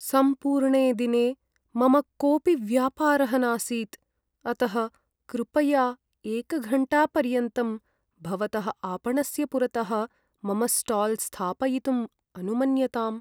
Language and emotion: Sanskrit, sad